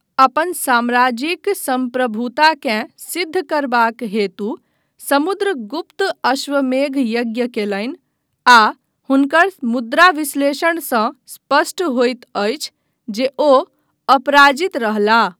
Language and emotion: Maithili, neutral